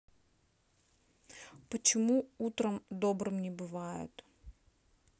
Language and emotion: Russian, sad